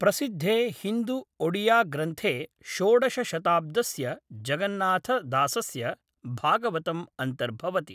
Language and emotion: Sanskrit, neutral